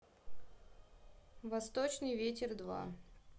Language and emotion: Russian, neutral